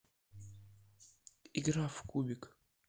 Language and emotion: Russian, neutral